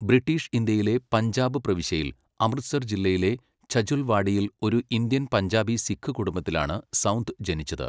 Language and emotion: Malayalam, neutral